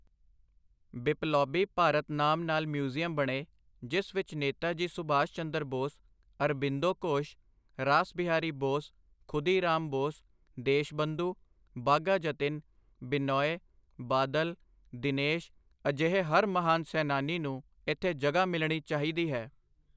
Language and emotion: Punjabi, neutral